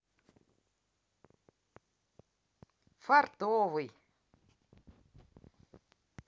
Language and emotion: Russian, positive